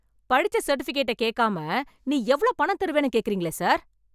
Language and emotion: Tamil, angry